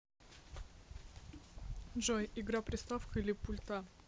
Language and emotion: Russian, neutral